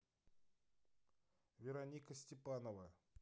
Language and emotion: Russian, neutral